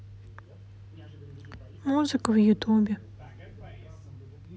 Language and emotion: Russian, sad